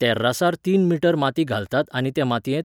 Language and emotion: Goan Konkani, neutral